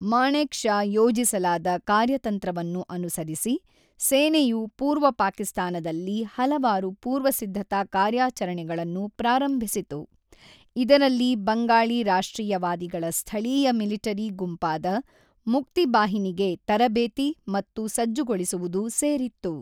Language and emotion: Kannada, neutral